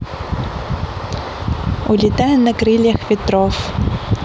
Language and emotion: Russian, positive